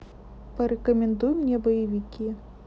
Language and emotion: Russian, neutral